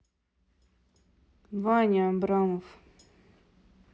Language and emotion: Russian, neutral